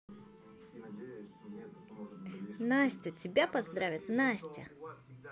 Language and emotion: Russian, positive